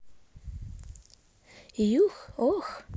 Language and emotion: Russian, positive